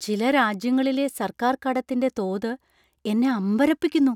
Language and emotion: Malayalam, surprised